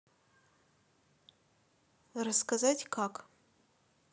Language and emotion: Russian, neutral